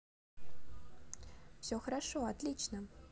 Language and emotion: Russian, positive